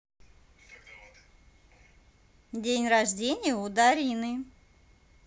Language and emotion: Russian, positive